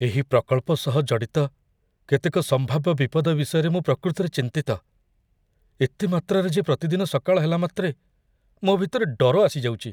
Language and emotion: Odia, fearful